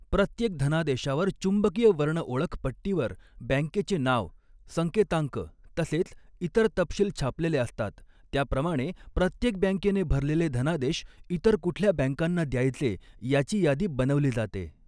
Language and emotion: Marathi, neutral